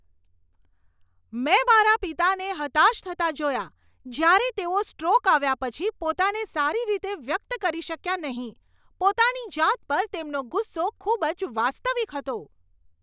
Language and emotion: Gujarati, angry